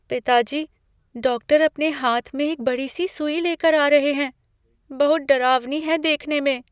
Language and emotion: Hindi, fearful